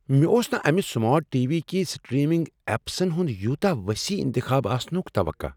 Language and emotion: Kashmiri, surprised